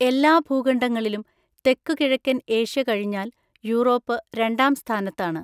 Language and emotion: Malayalam, neutral